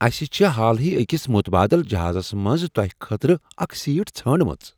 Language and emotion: Kashmiri, surprised